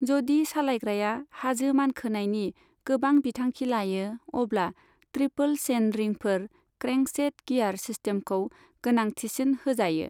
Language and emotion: Bodo, neutral